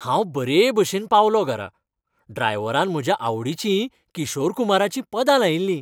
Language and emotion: Goan Konkani, happy